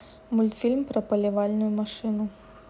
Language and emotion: Russian, neutral